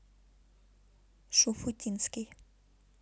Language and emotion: Russian, neutral